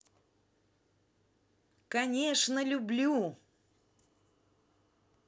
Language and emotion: Russian, positive